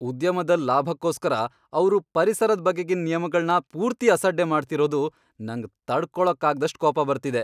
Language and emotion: Kannada, angry